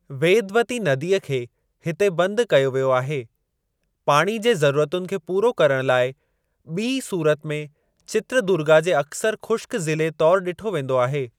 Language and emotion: Sindhi, neutral